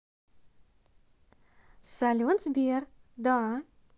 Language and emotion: Russian, positive